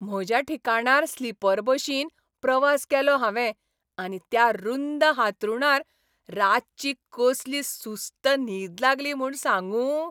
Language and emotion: Goan Konkani, happy